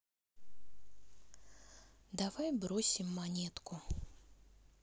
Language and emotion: Russian, sad